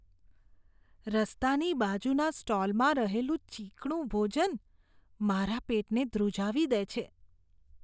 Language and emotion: Gujarati, disgusted